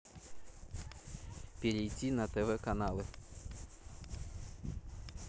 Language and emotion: Russian, neutral